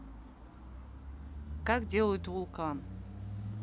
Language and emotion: Russian, neutral